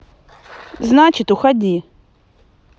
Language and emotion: Russian, angry